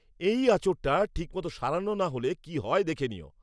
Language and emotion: Bengali, angry